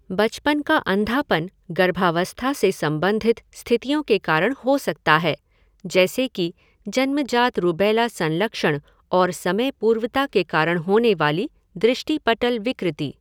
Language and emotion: Hindi, neutral